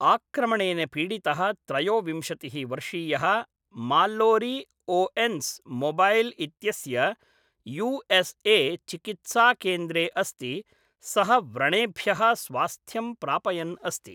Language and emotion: Sanskrit, neutral